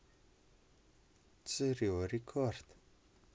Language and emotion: Russian, neutral